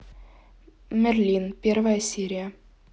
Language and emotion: Russian, neutral